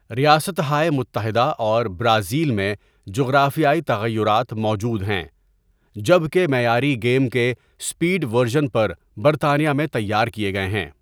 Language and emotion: Urdu, neutral